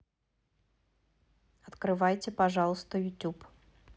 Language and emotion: Russian, neutral